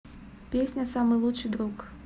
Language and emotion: Russian, neutral